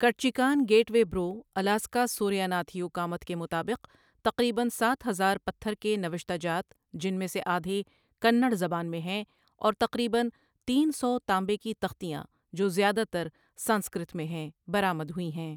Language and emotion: Urdu, neutral